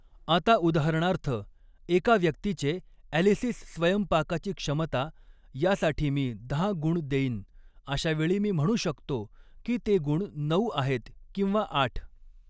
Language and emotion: Marathi, neutral